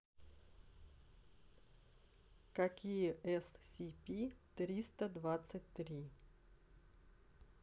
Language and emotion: Russian, neutral